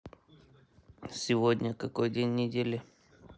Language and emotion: Russian, neutral